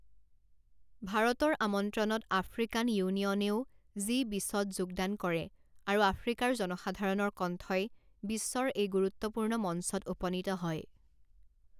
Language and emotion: Assamese, neutral